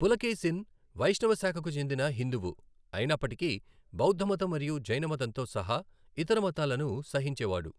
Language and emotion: Telugu, neutral